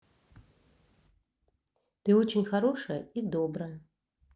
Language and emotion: Russian, positive